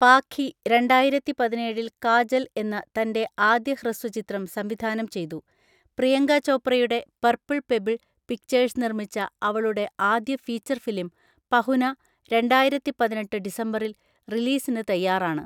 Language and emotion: Malayalam, neutral